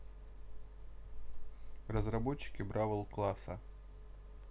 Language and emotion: Russian, neutral